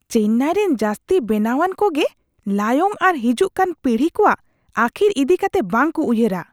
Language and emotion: Santali, disgusted